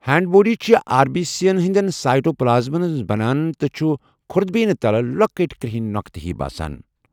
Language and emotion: Kashmiri, neutral